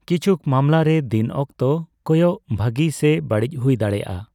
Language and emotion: Santali, neutral